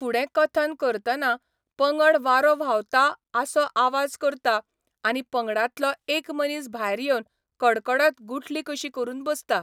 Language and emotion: Goan Konkani, neutral